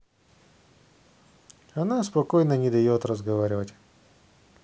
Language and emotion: Russian, neutral